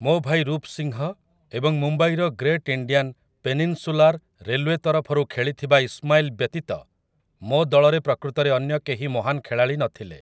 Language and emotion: Odia, neutral